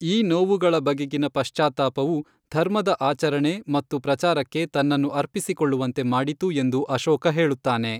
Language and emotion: Kannada, neutral